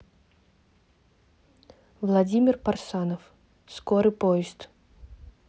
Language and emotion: Russian, neutral